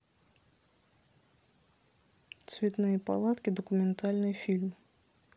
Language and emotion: Russian, neutral